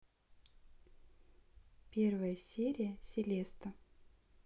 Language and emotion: Russian, neutral